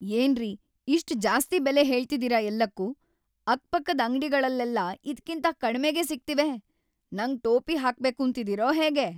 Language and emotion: Kannada, angry